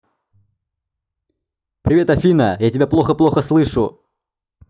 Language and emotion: Russian, angry